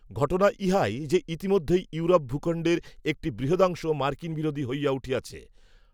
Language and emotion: Bengali, neutral